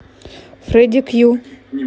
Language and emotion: Russian, neutral